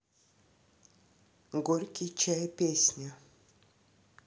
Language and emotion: Russian, neutral